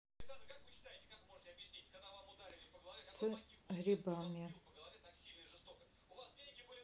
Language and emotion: Russian, neutral